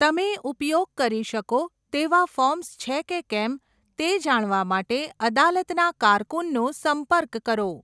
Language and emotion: Gujarati, neutral